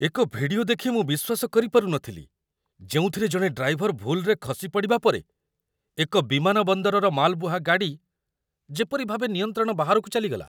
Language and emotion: Odia, surprised